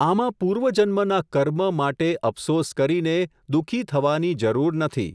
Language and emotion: Gujarati, neutral